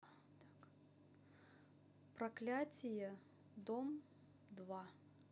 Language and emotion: Russian, neutral